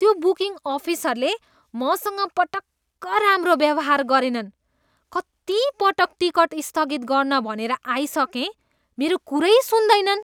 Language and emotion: Nepali, disgusted